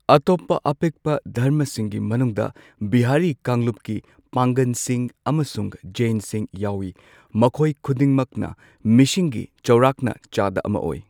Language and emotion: Manipuri, neutral